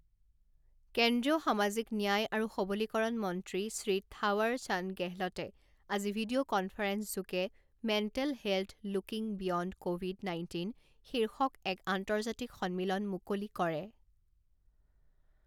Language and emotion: Assamese, neutral